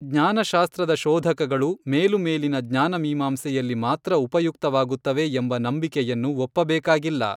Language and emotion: Kannada, neutral